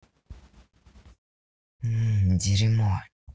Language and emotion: Russian, angry